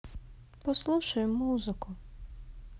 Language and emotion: Russian, sad